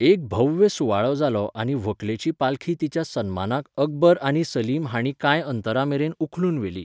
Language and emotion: Goan Konkani, neutral